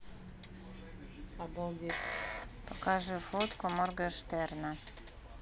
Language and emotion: Russian, neutral